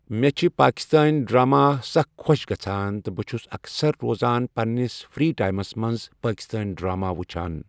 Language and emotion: Kashmiri, neutral